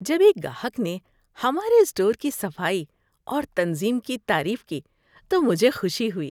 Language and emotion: Urdu, happy